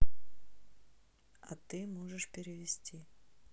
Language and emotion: Russian, neutral